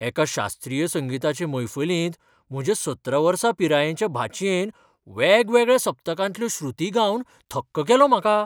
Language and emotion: Goan Konkani, surprised